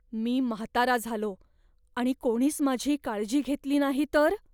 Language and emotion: Marathi, fearful